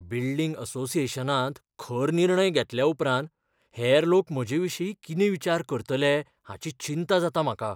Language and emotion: Goan Konkani, fearful